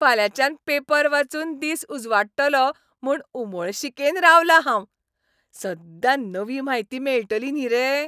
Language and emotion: Goan Konkani, happy